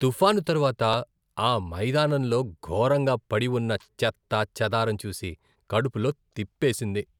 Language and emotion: Telugu, disgusted